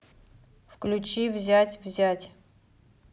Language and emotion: Russian, neutral